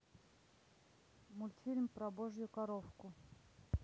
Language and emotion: Russian, neutral